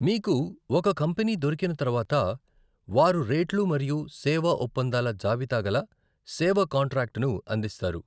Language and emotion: Telugu, neutral